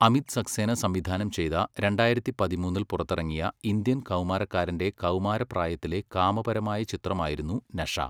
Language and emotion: Malayalam, neutral